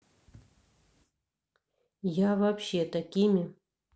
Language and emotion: Russian, neutral